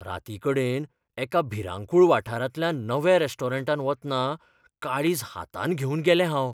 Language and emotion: Goan Konkani, fearful